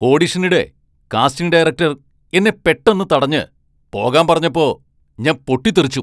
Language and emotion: Malayalam, angry